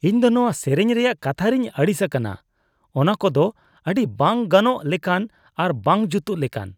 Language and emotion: Santali, disgusted